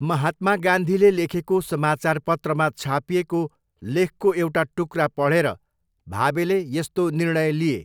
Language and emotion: Nepali, neutral